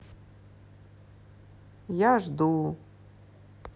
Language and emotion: Russian, sad